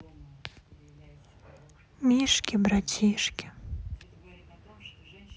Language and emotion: Russian, sad